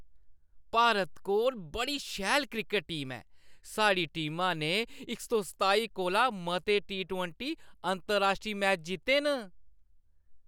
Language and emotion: Dogri, happy